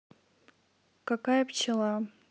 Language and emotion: Russian, neutral